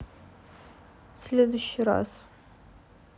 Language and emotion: Russian, neutral